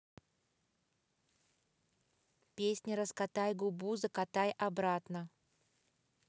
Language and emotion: Russian, positive